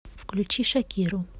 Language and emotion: Russian, neutral